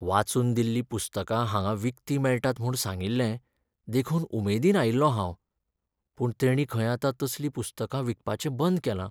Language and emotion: Goan Konkani, sad